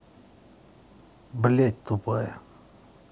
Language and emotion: Russian, angry